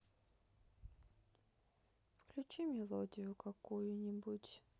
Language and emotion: Russian, sad